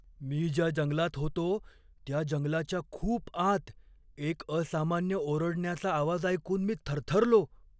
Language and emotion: Marathi, fearful